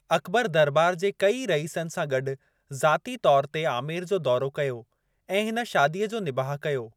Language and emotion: Sindhi, neutral